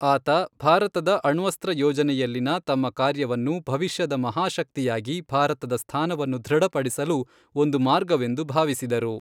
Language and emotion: Kannada, neutral